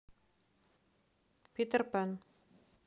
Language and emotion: Russian, neutral